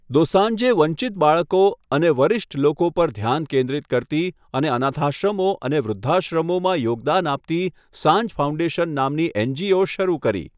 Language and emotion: Gujarati, neutral